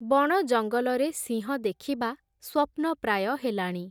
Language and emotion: Odia, neutral